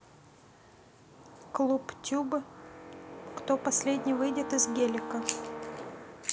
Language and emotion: Russian, neutral